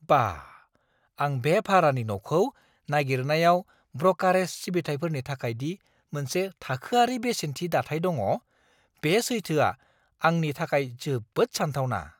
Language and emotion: Bodo, surprised